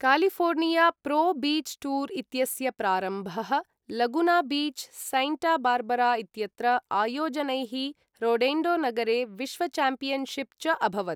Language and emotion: Sanskrit, neutral